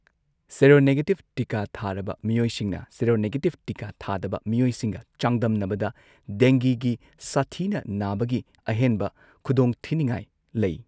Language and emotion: Manipuri, neutral